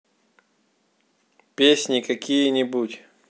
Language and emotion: Russian, neutral